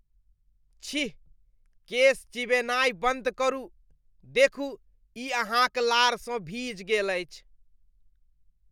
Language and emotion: Maithili, disgusted